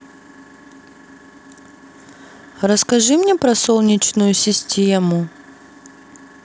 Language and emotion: Russian, neutral